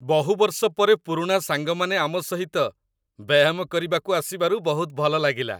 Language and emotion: Odia, happy